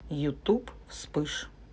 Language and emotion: Russian, neutral